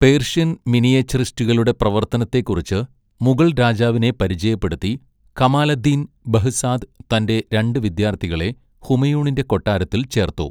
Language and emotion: Malayalam, neutral